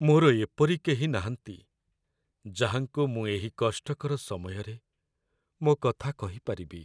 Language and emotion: Odia, sad